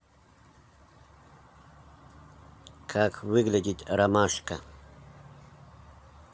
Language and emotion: Russian, neutral